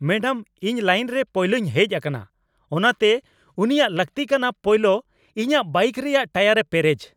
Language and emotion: Santali, angry